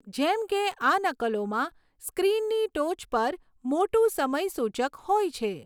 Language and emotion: Gujarati, neutral